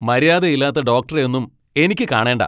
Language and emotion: Malayalam, angry